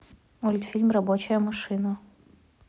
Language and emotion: Russian, neutral